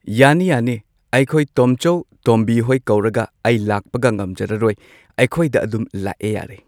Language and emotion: Manipuri, neutral